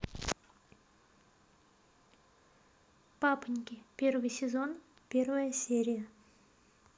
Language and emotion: Russian, neutral